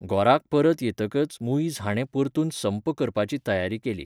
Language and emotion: Goan Konkani, neutral